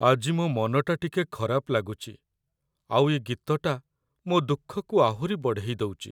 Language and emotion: Odia, sad